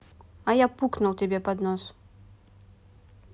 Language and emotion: Russian, neutral